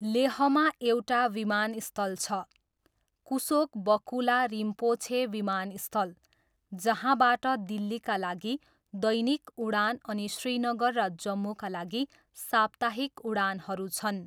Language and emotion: Nepali, neutral